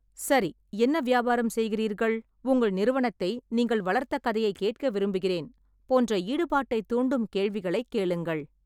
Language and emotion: Tamil, neutral